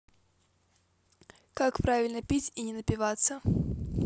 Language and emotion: Russian, neutral